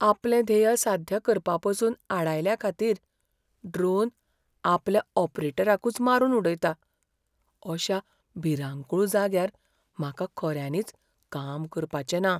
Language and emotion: Goan Konkani, fearful